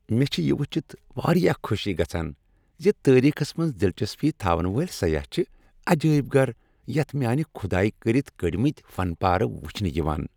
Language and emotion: Kashmiri, happy